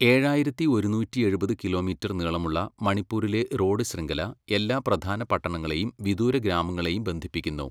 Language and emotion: Malayalam, neutral